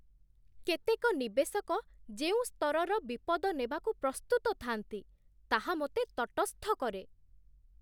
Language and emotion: Odia, surprised